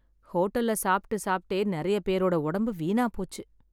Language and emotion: Tamil, sad